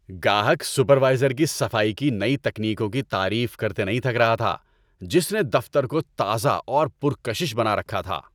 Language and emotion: Urdu, happy